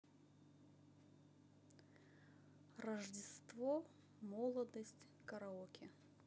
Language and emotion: Russian, neutral